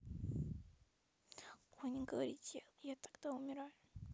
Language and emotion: Russian, sad